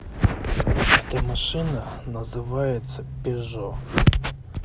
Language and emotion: Russian, neutral